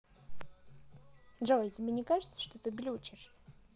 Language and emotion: Russian, neutral